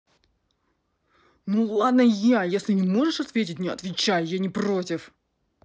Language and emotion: Russian, angry